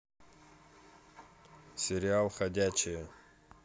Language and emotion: Russian, neutral